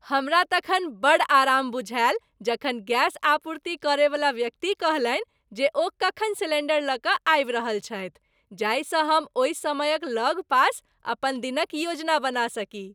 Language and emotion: Maithili, happy